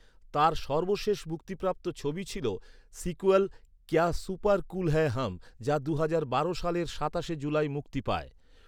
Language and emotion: Bengali, neutral